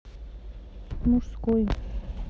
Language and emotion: Russian, neutral